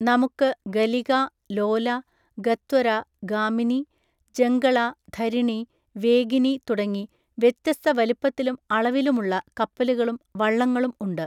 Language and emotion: Malayalam, neutral